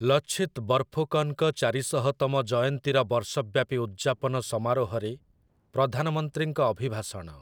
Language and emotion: Odia, neutral